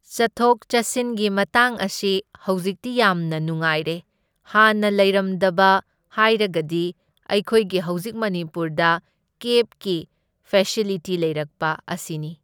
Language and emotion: Manipuri, neutral